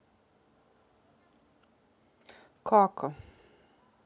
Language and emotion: Russian, sad